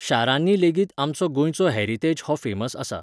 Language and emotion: Goan Konkani, neutral